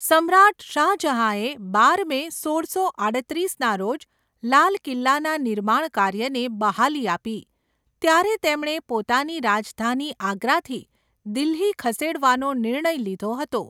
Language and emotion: Gujarati, neutral